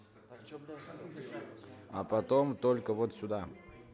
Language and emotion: Russian, neutral